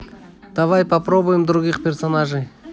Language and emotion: Russian, neutral